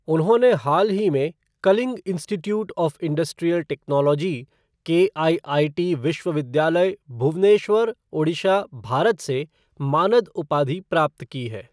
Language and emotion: Hindi, neutral